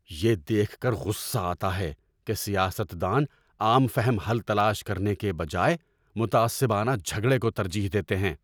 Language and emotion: Urdu, angry